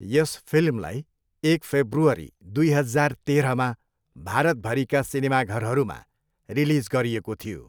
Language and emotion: Nepali, neutral